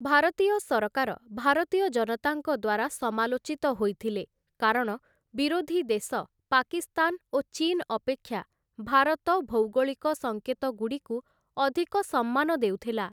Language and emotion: Odia, neutral